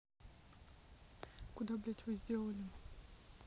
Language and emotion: Russian, neutral